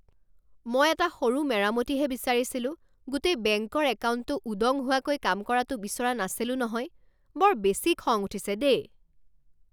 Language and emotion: Assamese, angry